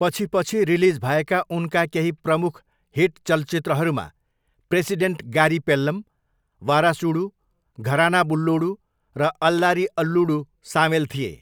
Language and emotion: Nepali, neutral